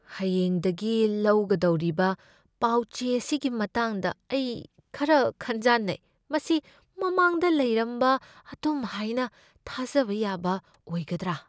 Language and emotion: Manipuri, fearful